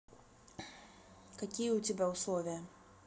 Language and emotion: Russian, neutral